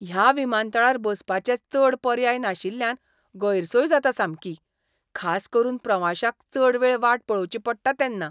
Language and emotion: Goan Konkani, disgusted